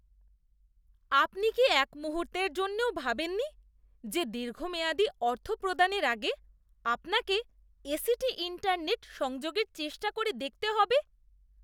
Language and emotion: Bengali, disgusted